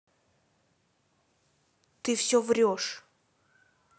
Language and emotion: Russian, angry